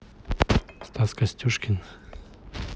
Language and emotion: Russian, neutral